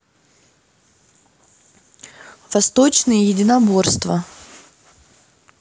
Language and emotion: Russian, neutral